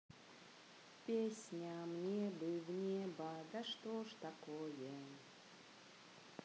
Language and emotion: Russian, positive